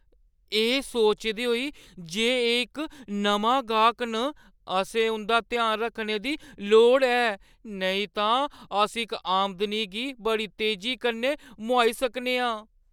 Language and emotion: Dogri, fearful